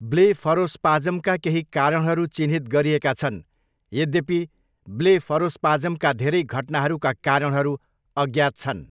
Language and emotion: Nepali, neutral